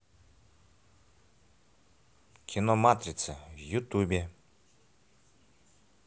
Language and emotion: Russian, neutral